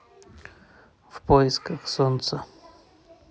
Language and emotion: Russian, neutral